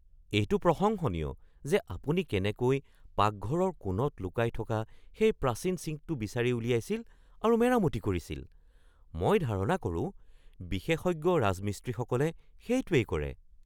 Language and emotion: Assamese, surprised